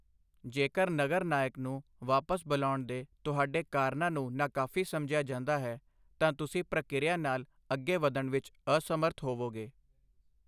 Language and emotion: Punjabi, neutral